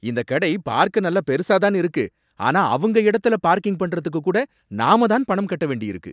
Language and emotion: Tamil, angry